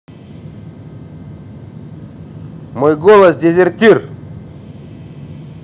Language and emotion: Russian, neutral